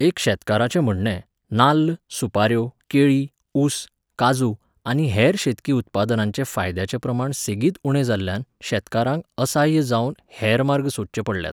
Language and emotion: Goan Konkani, neutral